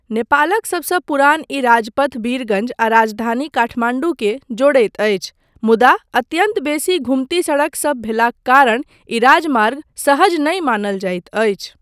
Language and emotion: Maithili, neutral